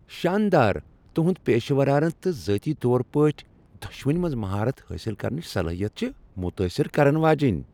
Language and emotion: Kashmiri, happy